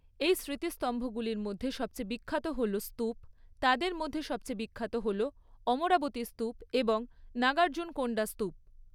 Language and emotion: Bengali, neutral